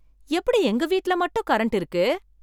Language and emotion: Tamil, surprised